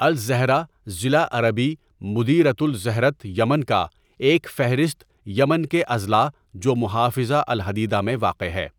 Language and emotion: Urdu, neutral